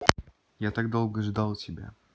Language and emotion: Russian, neutral